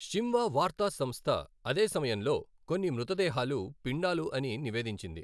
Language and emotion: Telugu, neutral